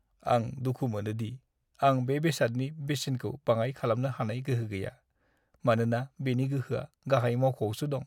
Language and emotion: Bodo, sad